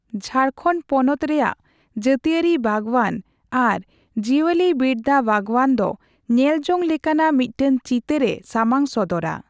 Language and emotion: Santali, neutral